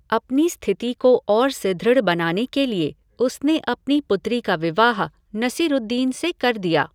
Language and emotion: Hindi, neutral